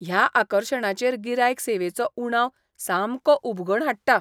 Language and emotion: Goan Konkani, disgusted